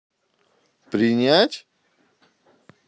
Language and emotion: Russian, neutral